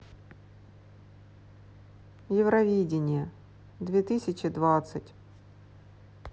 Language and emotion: Russian, neutral